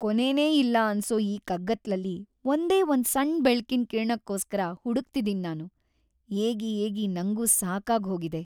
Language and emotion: Kannada, sad